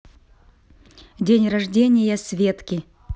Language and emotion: Russian, neutral